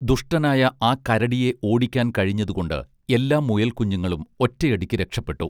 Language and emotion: Malayalam, neutral